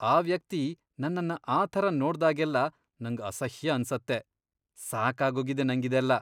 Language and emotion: Kannada, disgusted